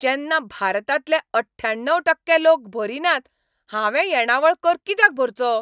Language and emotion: Goan Konkani, angry